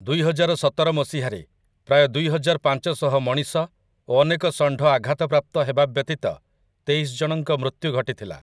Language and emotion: Odia, neutral